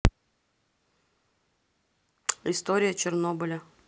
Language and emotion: Russian, neutral